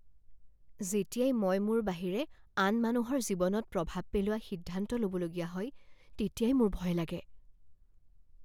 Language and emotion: Assamese, fearful